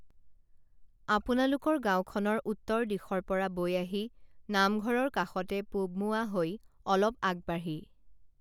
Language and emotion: Assamese, neutral